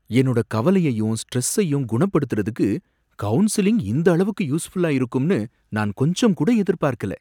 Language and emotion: Tamil, surprised